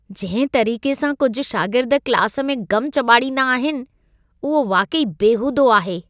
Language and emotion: Sindhi, disgusted